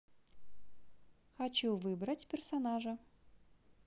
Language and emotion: Russian, positive